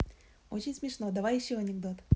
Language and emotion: Russian, positive